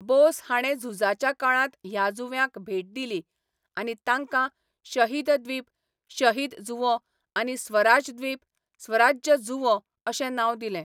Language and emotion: Goan Konkani, neutral